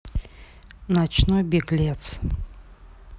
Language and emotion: Russian, neutral